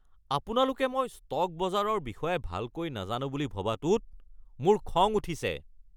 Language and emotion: Assamese, angry